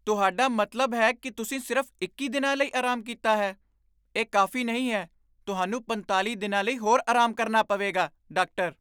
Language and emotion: Punjabi, surprised